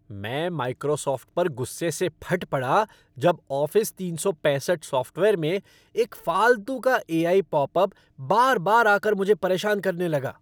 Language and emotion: Hindi, angry